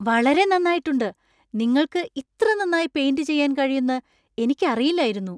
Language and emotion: Malayalam, surprised